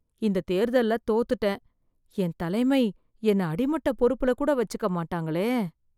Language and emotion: Tamil, fearful